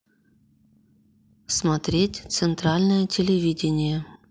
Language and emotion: Russian, neutral